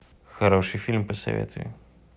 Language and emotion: Russian, neutral